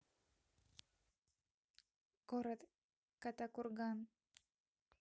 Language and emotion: Russian, neutral